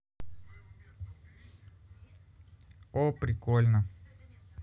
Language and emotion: Russian, positive